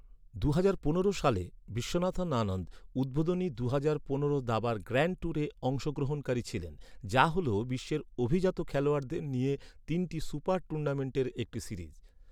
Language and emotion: Bengali, neutral